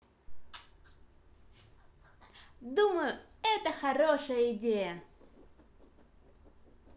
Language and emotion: Russian, positive